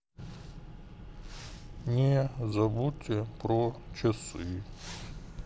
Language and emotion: Russian, sad